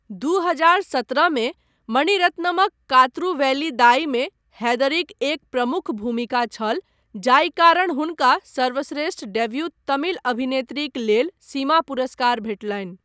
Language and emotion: Maithili, neutral